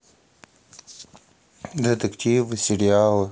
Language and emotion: Russian, neutral